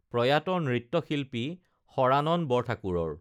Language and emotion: Assamese, neutral